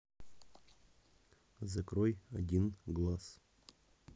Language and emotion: Russian, neutral